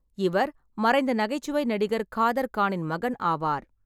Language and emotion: Tamil, neutral